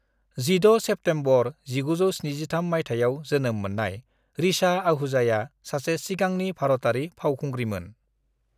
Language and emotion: Bodo, neutral